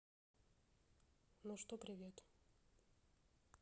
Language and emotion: Russian, neutral